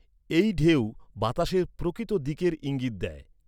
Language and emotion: Bengali, neutral